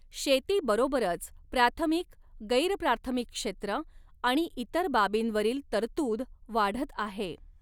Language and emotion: Marathi, neutral